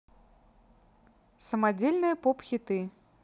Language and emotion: Russian, neutral